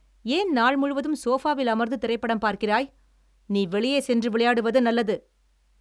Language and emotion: Tamil, angry